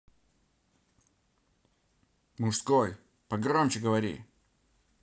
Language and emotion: Russian, angry